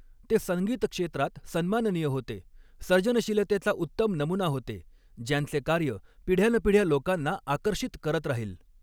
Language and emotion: Marathi, neutral